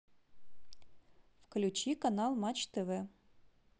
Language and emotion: Russian, neutral